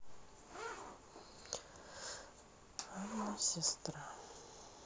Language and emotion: Russian, sad